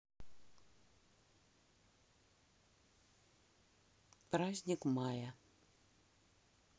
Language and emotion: Russian, neutral